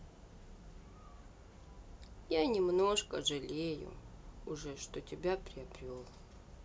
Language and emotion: Russian, sad